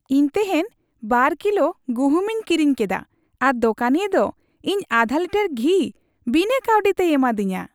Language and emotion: Santali, happy